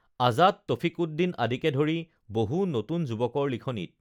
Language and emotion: Assamese, neutral